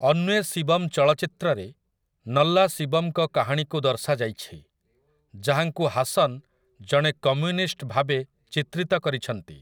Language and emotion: Odia, neutral